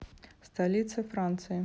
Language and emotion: Russian, neutral